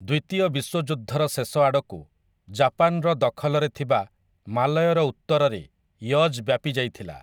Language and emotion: Odia, neutral